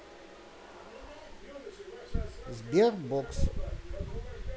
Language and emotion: Russian, neutral